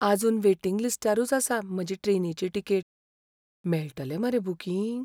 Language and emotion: Goan Konkani, fearful